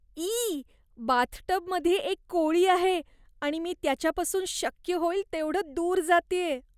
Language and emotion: Marathi, disgusted